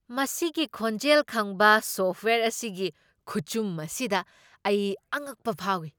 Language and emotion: Manipuri, surprised